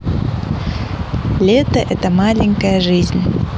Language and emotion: Russian, positive